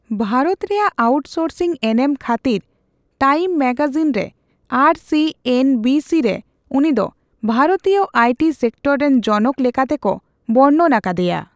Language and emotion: Santali, neutral